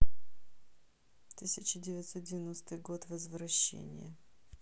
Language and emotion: Russian, neutral